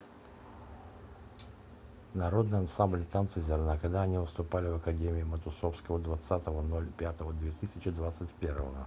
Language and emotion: Russian, neutral